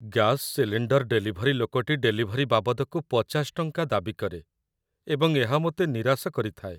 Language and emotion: Odia, sad